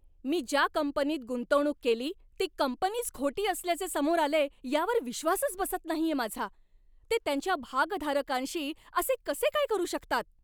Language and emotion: Marathi, angry